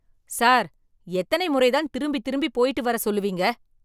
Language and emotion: Tamil, angry